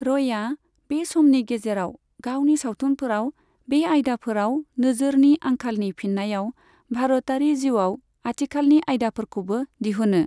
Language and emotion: Bodo, neutral